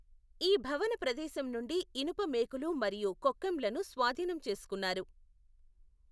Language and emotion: Telugu, neutral